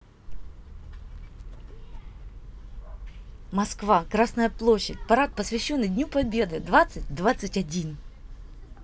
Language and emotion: Russian, positive